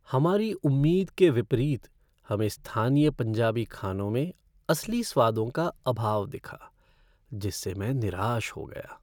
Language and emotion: Hindi, sad